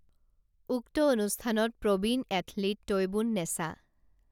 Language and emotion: Assamese, neutral